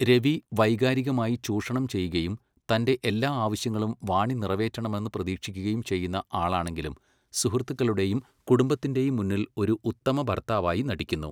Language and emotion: Malayalam, neutral